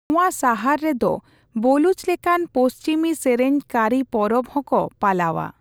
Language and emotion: Santali, neutral